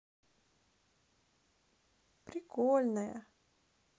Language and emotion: Russian, positive